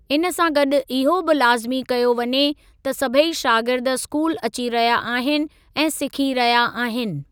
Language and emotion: Sindhi, neutral